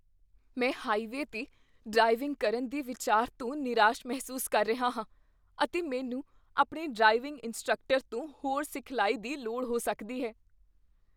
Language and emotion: Punjabi, fearful